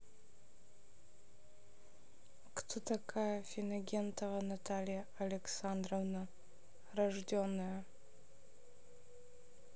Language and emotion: Russian, neutral